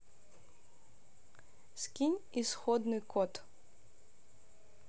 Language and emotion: Russian, neutral